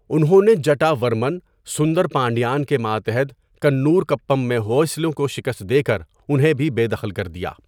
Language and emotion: Urdu, neutral